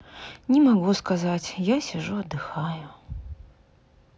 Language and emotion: Russian, sad